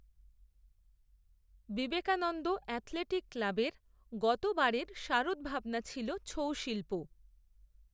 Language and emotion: Bengali, neutral